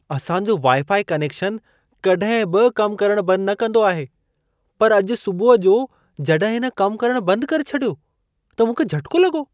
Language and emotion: Sindhi, surprised